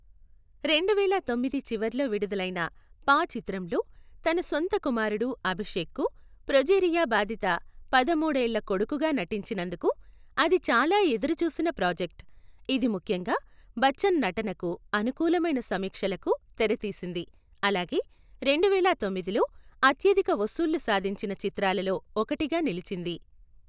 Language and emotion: Telugu, neutral